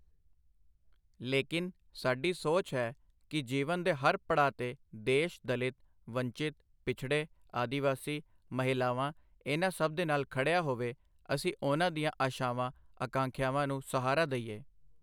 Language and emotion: Punjabi, neutral